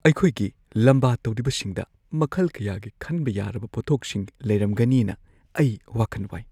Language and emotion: Manipuri, fearful